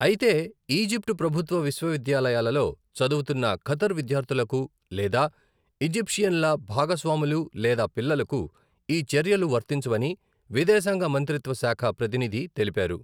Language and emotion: Telugu, neutral